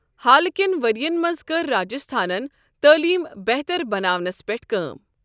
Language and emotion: Kashmiri, neutral